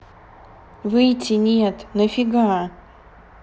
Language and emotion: Russian, neutral